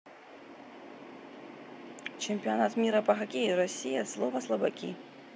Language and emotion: Russian, neutral